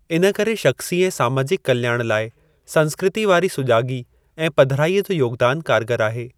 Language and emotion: Sindhi, neutral